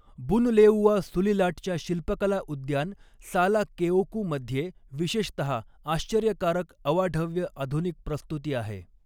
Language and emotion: Marathi, neutral